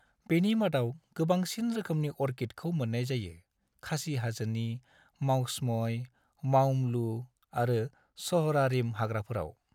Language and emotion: Bodo, neutral